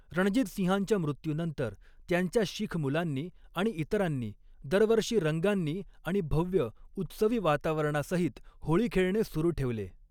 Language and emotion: Marathi, neutral